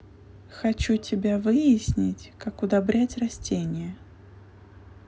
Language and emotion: Russian, neutral